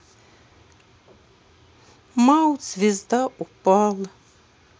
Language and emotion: Russian, sad